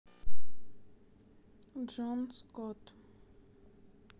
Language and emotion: Russian, sad